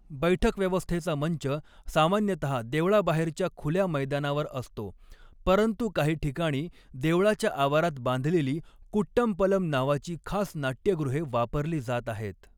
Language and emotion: Marathi, neutral